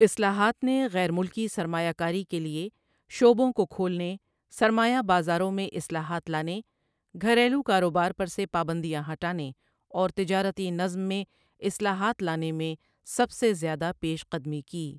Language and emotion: Urdu, neutral